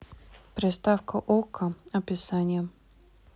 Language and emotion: Russian, neutral